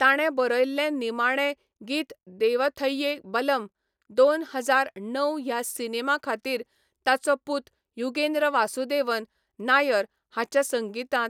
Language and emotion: Goan Konkani, neutral